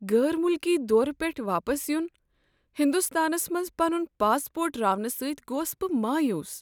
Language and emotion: Kashmiri, sad